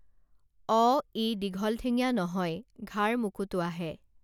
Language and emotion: Assamese, neutral